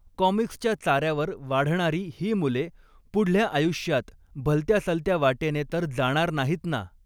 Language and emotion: Marathi, neutral